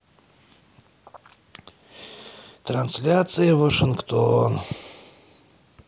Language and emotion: Russian, sad